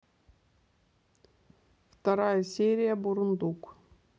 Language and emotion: Russian, neutral